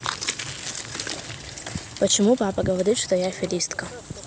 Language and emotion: Russian, neutral